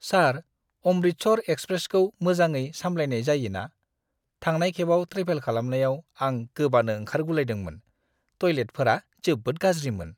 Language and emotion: Bodo, disgusted